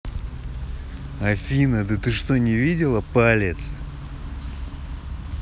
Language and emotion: Russian, angry